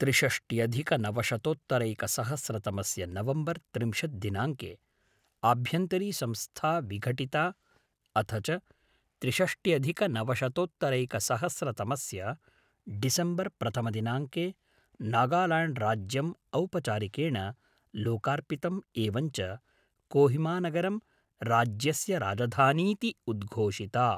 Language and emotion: Sanskrit, neutral